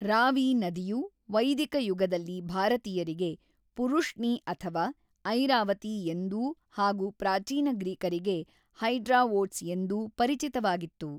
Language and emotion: Kannada, neutral